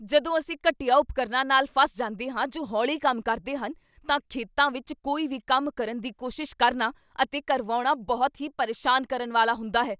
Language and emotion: Punjabi, angry